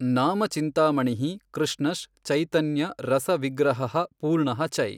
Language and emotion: Kannada, neutral